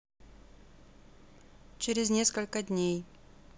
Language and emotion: Russian, neutral